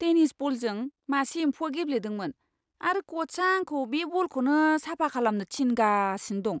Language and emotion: Bodo, disgusted